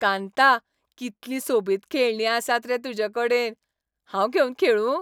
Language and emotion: Goan Konkani, happy